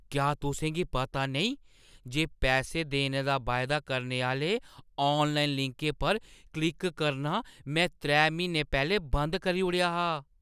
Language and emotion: Dogri, surprised